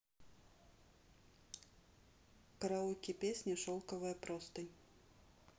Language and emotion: Russian, neutral